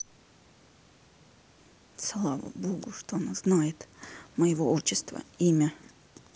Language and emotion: Russian, neutral